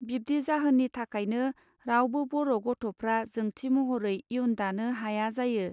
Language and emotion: Bodo, neutral